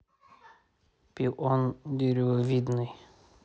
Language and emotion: Russian, neutral